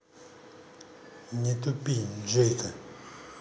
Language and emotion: Russian, neutral